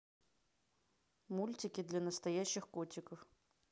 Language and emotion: Russian, neutral